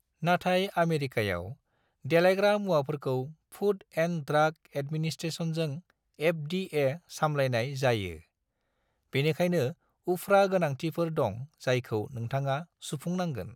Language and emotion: Bodo, neutral